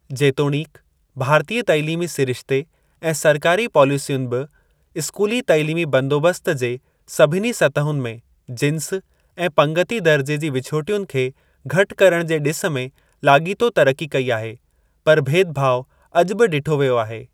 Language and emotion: Sindhi, neutral